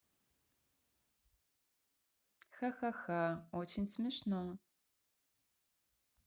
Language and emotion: Russian, positive